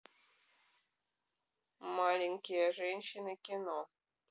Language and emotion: Russian, neutral